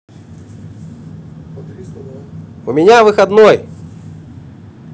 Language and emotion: Russian, positive